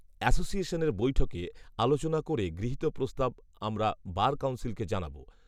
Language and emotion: Bengali, neutral